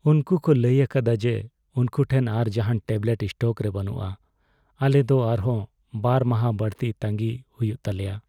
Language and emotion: Santali, sad